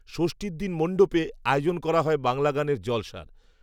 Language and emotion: Bengali, neutral